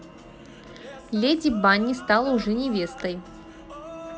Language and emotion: Russian, positive